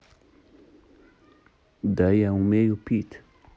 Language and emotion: Russian, neutral